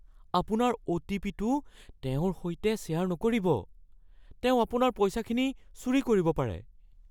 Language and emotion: Assamese, fearful